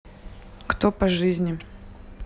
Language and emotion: Russian, neutral